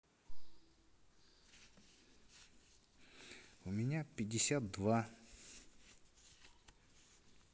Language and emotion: Russian, neutral